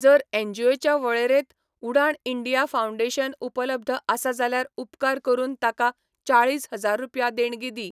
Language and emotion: Goan Konkani, neutral